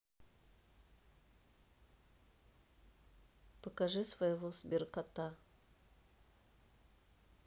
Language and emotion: Russian, neutral